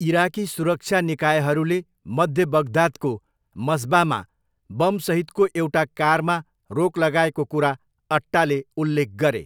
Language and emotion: Nepali, neutral